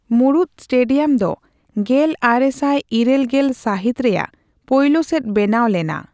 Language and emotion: Santali, neutral